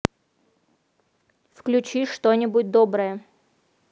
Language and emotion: Russian, neutral